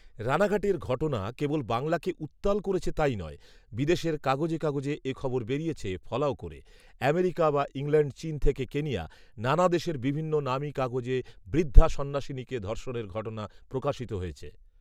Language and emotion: Bengali, neutral